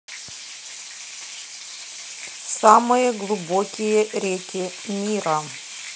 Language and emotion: Russian, neutral